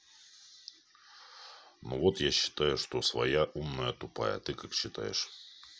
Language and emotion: Russian, neutral